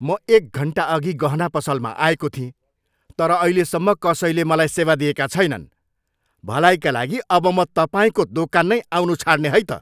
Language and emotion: Nepali, angry